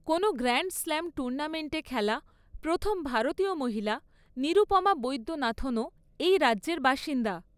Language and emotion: Bengali, neutral